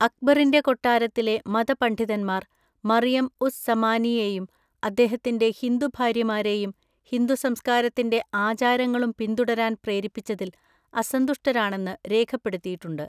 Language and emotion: Malayalam, neutral